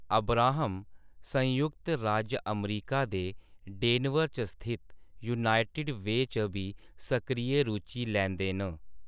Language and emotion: Dogri, neutral